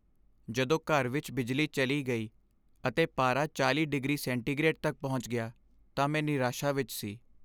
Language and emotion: Punjabi, sad